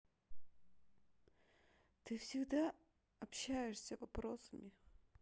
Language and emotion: Russian, sad